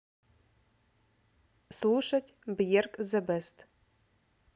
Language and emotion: Russian, neutral